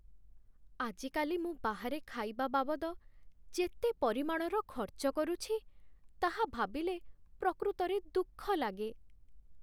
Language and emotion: Odia, sad